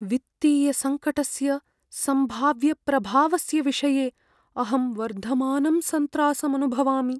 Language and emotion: Sanskrit, fearful